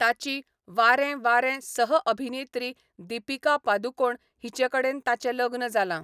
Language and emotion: Goan Konkani, neutral